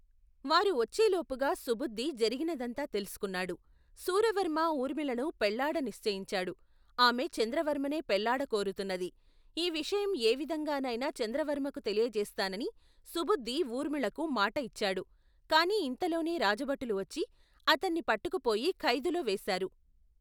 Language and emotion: Telugu, neutral